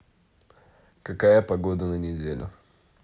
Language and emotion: Russian, neutral